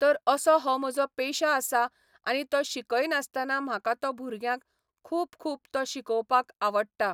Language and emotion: Goan Konkani, neutral